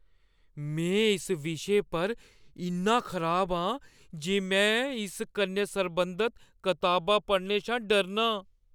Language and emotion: Dogri, fearful